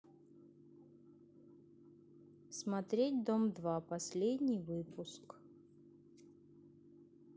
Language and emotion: Russian, neutral